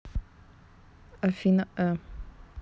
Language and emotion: Russian, neutral